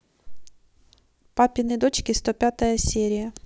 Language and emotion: Russian, neutral